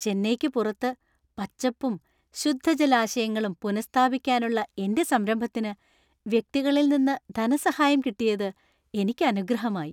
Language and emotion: Malayalam, happy